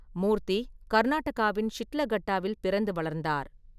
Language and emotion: Tamil, neutral